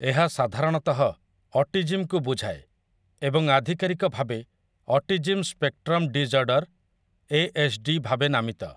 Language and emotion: Odia, neutral